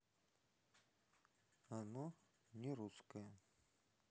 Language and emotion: Russian, neutral